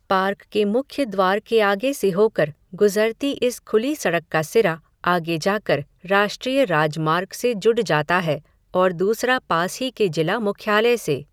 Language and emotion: Hindi, neutral